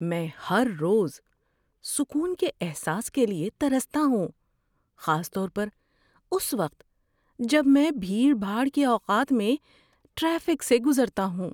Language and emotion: Urdu, sad